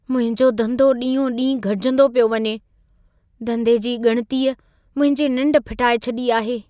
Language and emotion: Sindhi, fearful